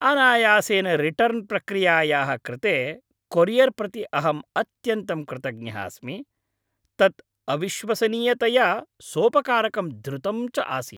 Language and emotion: Sanskrit, happy